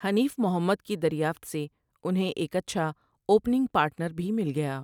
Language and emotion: Urdu, neutral